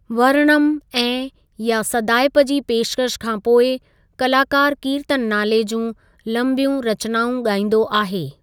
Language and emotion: Sindhi, neutral